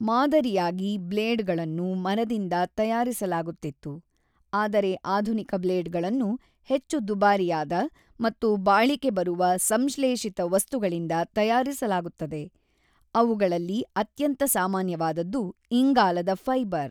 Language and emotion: Kannada, neutral